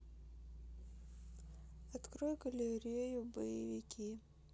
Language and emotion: Russian, sad